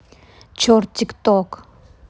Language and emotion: Russian, neutral